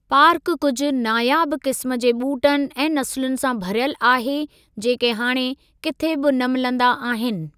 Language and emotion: Sindhi, neutral